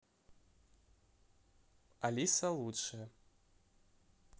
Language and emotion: Russian, neutral